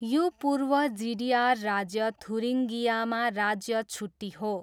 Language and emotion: Nepali, neutral